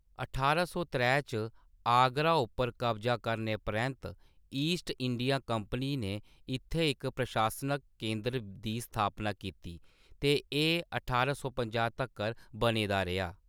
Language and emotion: Dogri, neutral